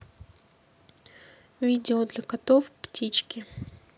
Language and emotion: Russian, neutral